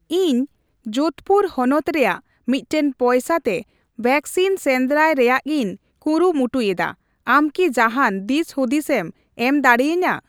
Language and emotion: Santali, neutral